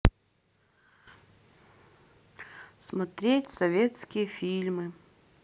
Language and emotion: Russian, sad